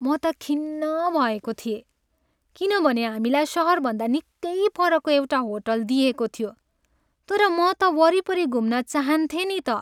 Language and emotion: Nepali, sad